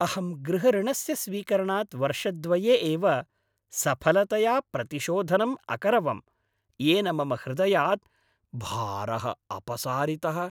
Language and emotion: Sanskrit, happy